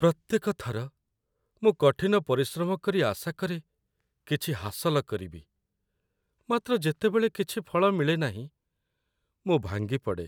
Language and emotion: Odia, sad